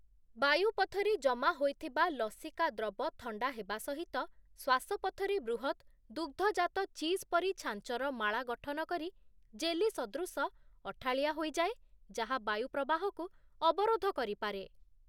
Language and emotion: Odia, neutral